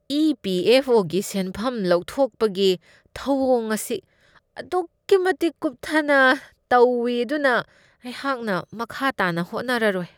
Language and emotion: Manipuri, disgusted